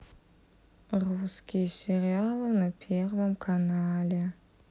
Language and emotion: Russian, sad